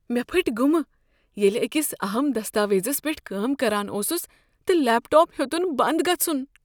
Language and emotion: Kashmiri, fearful